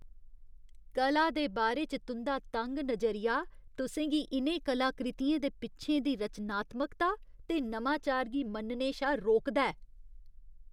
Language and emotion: Dogri, disgusted